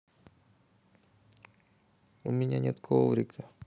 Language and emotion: Russian, sad